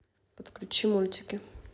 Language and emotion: Russian, neutral